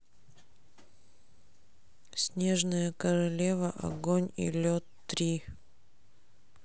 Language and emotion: Russian, sad